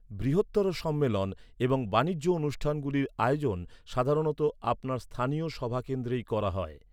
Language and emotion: Bengali, neutral